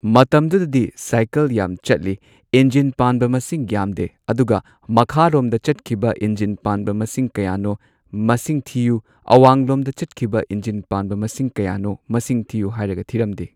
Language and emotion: Manipuri, neutral